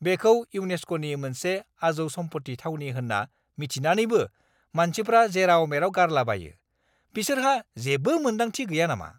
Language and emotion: Bodo, angry